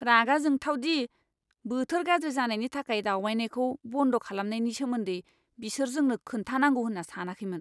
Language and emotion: Bodo, angry